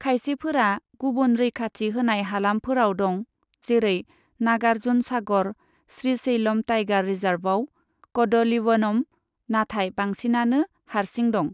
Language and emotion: Bodo, neutral